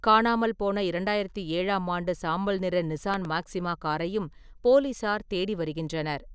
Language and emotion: Tamil, neutral